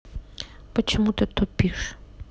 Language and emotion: Russian, neutral